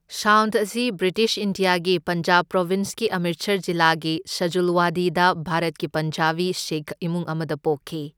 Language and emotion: Manipuri, neutral